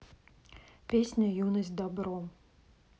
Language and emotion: Russian, neutral